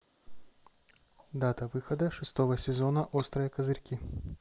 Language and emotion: Russian, neutral